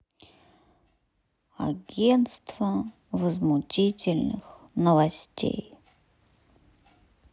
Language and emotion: Russian, sad